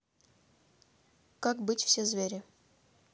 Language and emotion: Russian, neutral